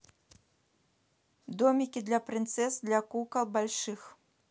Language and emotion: Russian, neutral